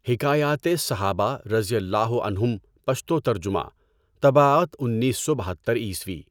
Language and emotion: Urdu, neutral